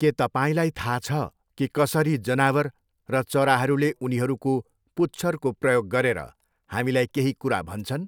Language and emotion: Nepali, neutral